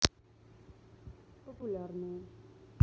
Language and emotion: Russian, neutral